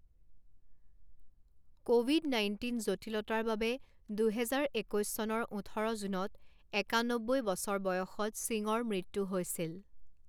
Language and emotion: Assamese, neutral